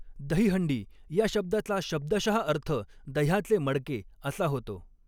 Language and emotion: Marathi, neutral